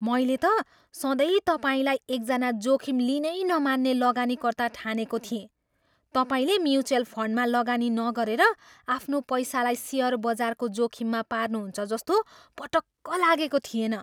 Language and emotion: Nepali, surprised